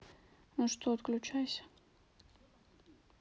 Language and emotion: Russian, neutral